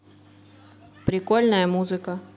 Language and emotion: Russian, neutral